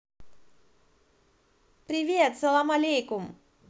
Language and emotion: Russian, positive